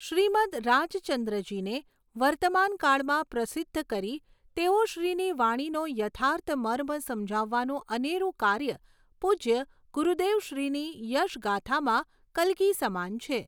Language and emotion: Gujarati, neutral